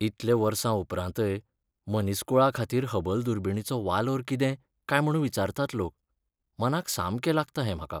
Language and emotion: Goan Konkani, sad